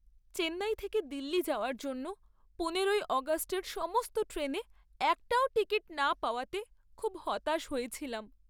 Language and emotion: Bengali, sad